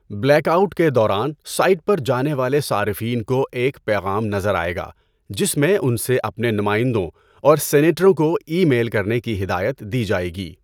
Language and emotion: Urdu, neutral